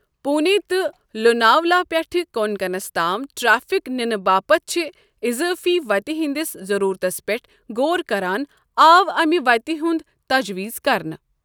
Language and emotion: Kashmiri, neutral